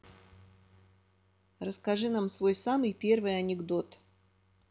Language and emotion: Russian, neutral